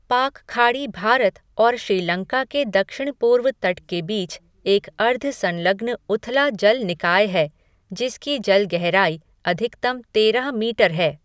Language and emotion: Hindi, neutral